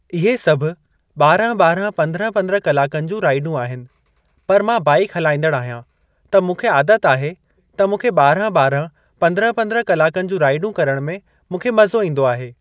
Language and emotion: Sindhi, neutral